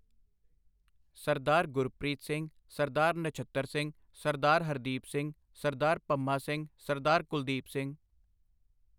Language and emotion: Punjabi, neutral